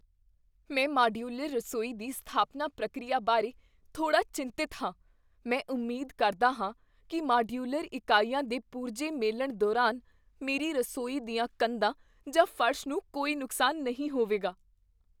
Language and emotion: Punjabi, fearful